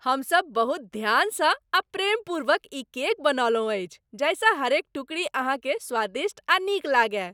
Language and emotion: Maithili, happy